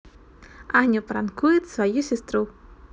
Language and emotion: Russian, positive